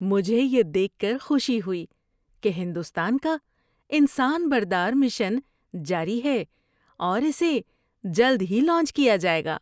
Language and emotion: Urdu, happy